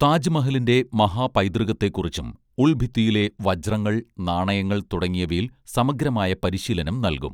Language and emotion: Malayalam, neutral